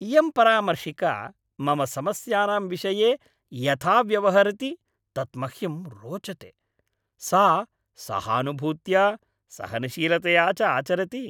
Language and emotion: Sanskrit, happy